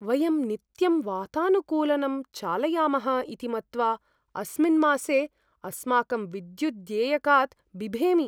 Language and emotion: Sanskrit, fearful